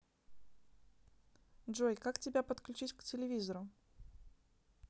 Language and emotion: Russian, neutral